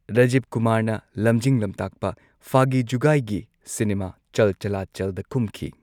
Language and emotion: Manipuri, neutral